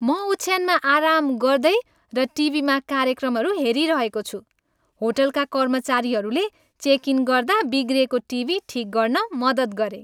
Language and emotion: Nepali, happy